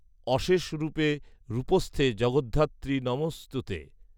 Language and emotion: Bengali, neutral